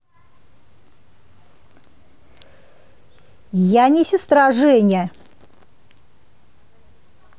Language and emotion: Russian, angry